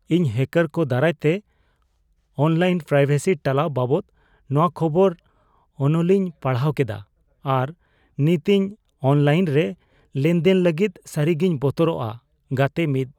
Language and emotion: Santali, fearful